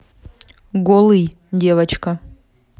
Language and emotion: Russian, neutral